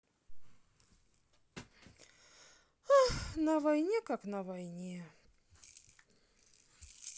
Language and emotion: Russian, sad